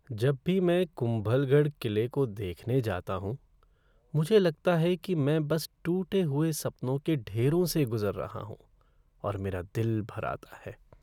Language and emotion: Hindi, sad